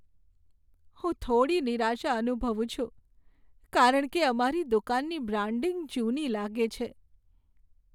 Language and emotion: Gujarati, sad